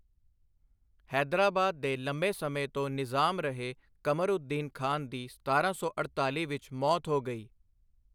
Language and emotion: Punjabi, neutral